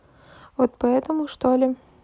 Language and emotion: Russian, neutral